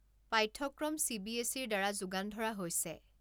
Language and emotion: Assamese, neutral